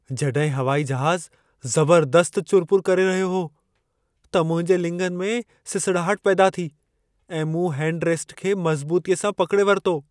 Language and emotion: Sindhi, fearful